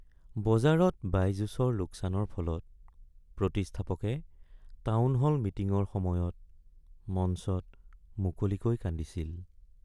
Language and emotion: Assamese, sad